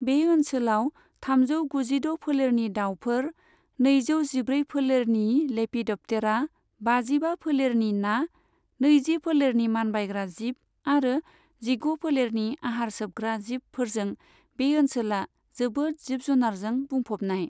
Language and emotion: Bodo, neutral